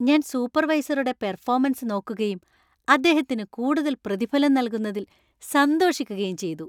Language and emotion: Malayalam, happy